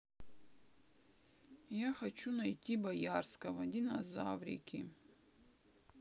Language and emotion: Russian, sad